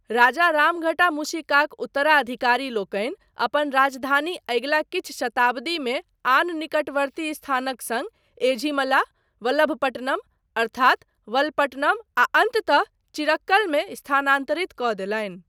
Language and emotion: Maithili, neutral